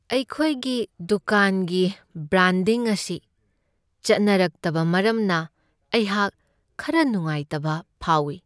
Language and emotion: Manipuri, sad